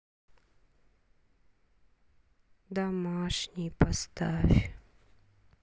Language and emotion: Russian, sad